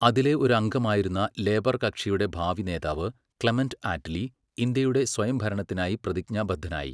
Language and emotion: Malayalam, neutral